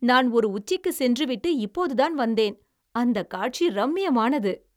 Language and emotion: Tamil, happy